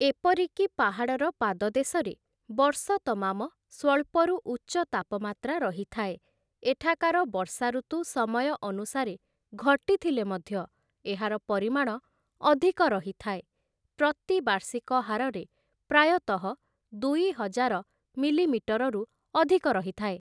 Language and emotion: Odia, neutral